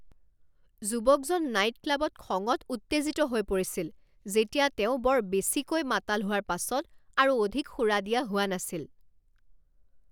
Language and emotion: Assamese, angry